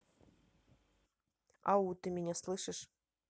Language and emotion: Russian, neutral